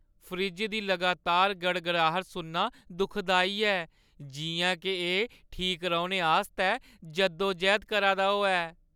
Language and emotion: Dogri, sad